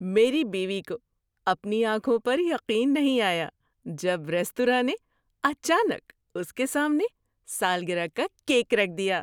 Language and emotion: Urdu, surprised